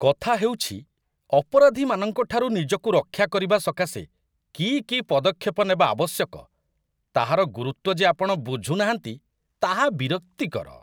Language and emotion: Odia, disgusted